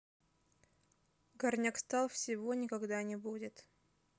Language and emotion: Russian, sad